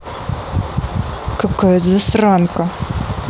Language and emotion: Russian, angry